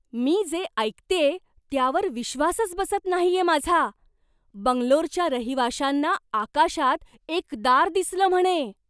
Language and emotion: Marathi, surprised